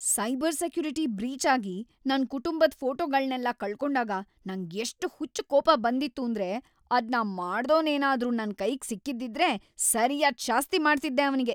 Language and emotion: Kannada, angry